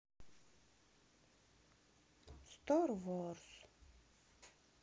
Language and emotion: Russian, sad